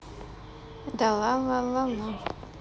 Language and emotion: Russian, neutral